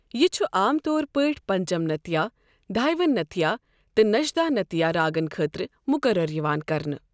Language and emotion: Kashmiri, neutral